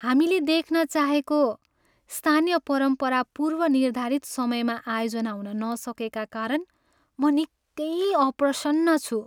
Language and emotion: Nepali, sad